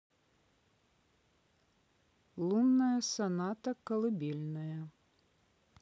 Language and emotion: Russian, neutral